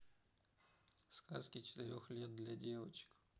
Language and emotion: Russian, neutral